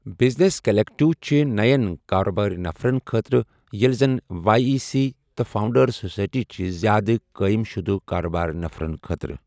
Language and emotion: Kashmiri, neutral